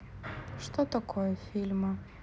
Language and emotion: Russian, neutral